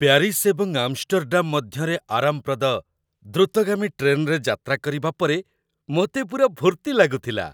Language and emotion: Odia, happy